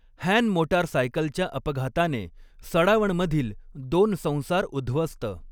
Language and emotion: Marathi, neutral